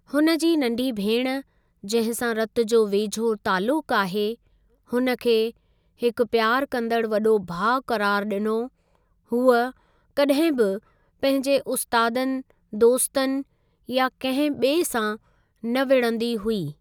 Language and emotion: Sindhi, neutral